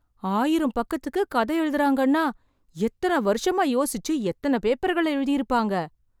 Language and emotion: Tamil, surprised